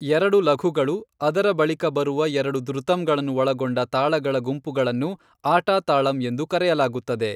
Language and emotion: Kannada, neutral